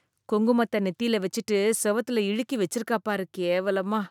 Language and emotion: Tamil, disgusted